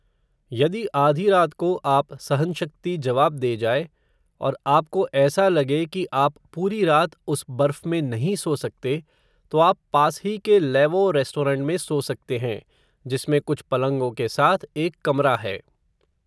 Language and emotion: Hindi, neutral